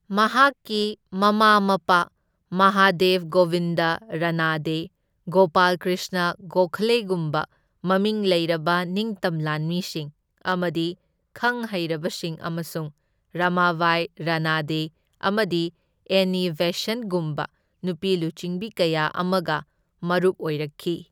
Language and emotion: Manipuri, neutral